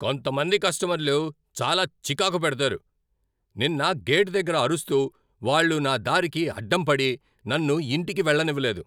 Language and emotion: Telugu, angry